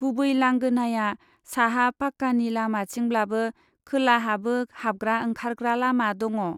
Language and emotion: Bodo, neutral